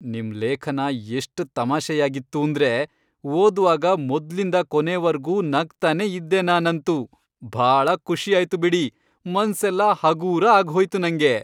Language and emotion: Kannada, happy